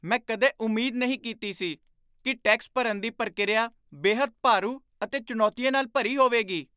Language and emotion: Punjabi, surprised